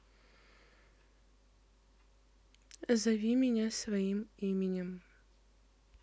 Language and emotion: Russian, neutral